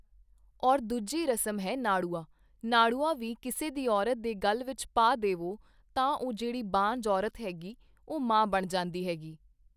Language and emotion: Punjabi, neutral